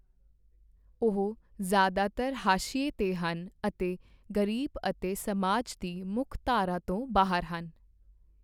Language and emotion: Punjabi, neutral